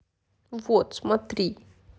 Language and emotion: Russian, sad